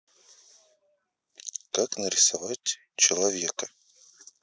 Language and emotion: Russian, neutral